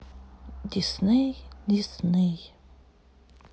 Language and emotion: Russian, sad